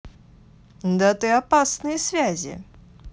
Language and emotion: Russian, neutral